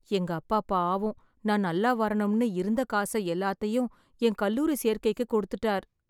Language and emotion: Tamil, sad